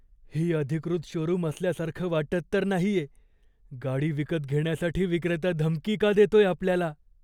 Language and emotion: Marathi, fearful